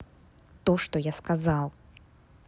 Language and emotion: Russian, angry